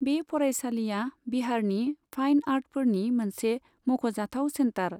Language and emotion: Bodo, neutral